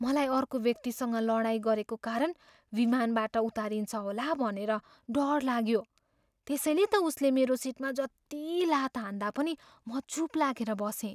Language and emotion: Nepali, fearful